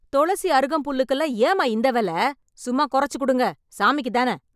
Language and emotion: Tamil, angry